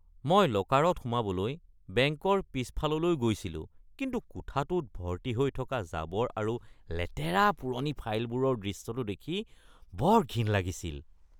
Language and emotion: Assamese, disgusted